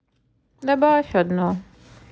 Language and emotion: Russian, sad